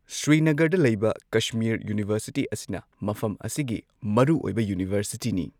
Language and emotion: Manipuri, neutral